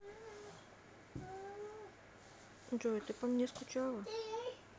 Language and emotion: Russian, sad